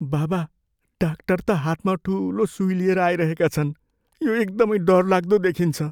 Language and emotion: Nepali, fearful